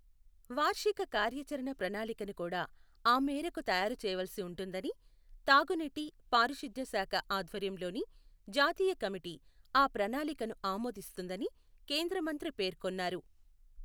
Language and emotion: Telugu, neutral